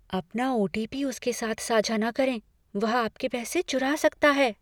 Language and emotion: Hindi, fearful